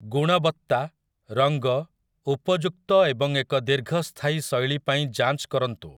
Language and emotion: Odia, neutral